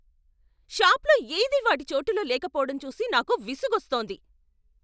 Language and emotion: Telugu, angry